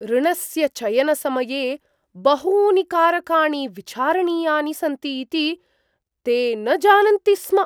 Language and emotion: Sanskrit, surprised